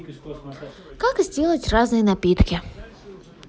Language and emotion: Russian, neutral